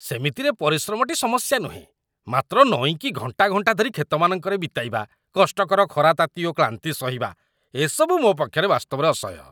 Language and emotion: Odia, disgusted